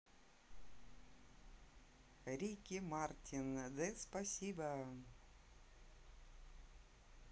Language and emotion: Russian, neutral